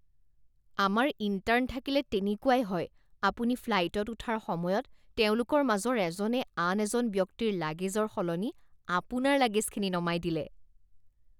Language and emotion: Assamese, disgusted